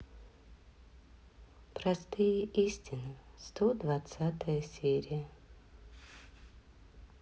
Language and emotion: Russian, sad